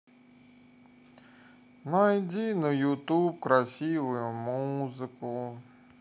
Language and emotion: Russian, sad